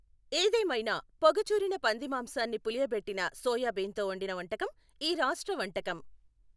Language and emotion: Telugu, neutral